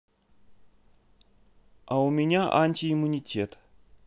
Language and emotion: Russian, neutral